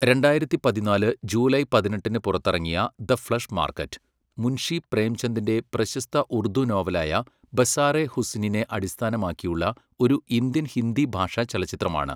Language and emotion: Malayalam, neutral